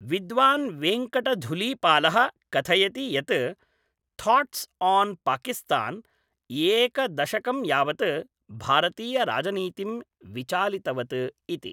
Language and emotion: Sanskrit, neutral